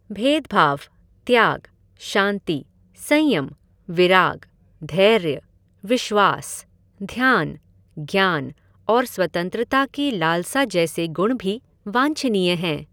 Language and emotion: Hindi, neutral